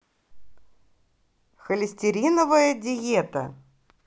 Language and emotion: Russian, positive